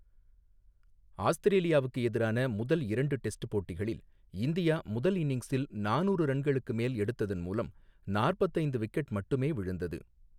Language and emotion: Tamil, neutral